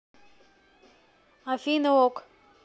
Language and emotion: Russian, neutral